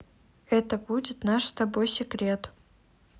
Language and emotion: Russian, neutral